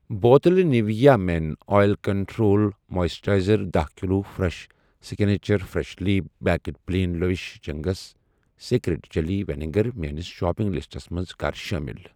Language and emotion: Kashmiri, neutral